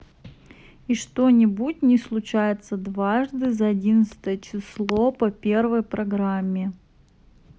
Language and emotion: Russian, neutral